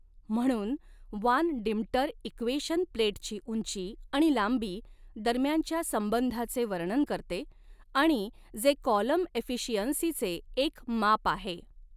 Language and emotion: Marathi, neutral